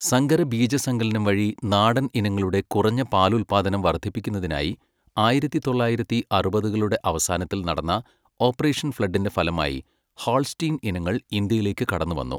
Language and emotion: Malayalam, neutral